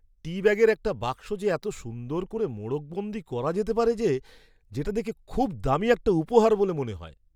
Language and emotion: Bengali, surprised